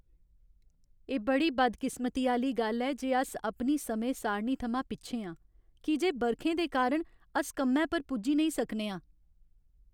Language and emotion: Dogri, sad